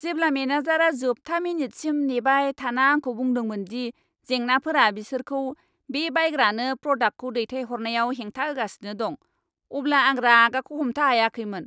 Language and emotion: Bodo, angry